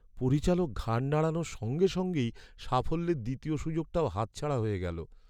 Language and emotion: Bengali, sad